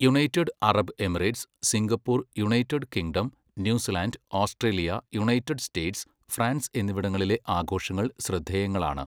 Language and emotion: Malayalam, neutral